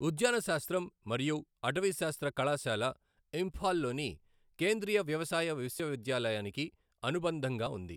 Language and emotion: Telugu, neutral